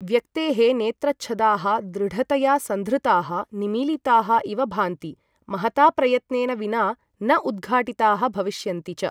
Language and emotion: Sanskrit, neutral